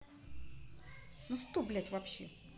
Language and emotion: Russian, angry